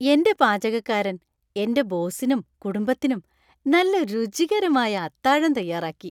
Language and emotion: Malayalam, happy